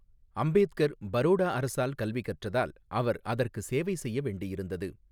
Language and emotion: Tamil, neutral